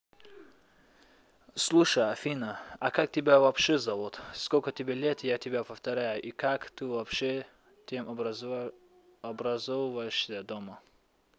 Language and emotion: Russian, neutral